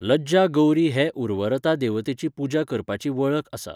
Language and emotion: Goan Konkani, neutral